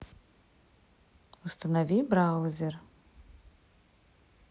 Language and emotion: Russian, neutral